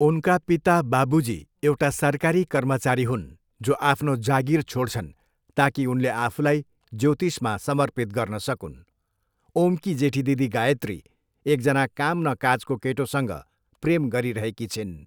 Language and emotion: Nepali, neutral